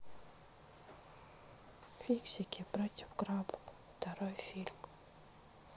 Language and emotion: Russian, sad